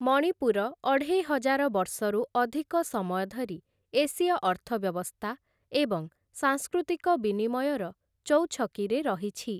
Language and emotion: Odia, neutral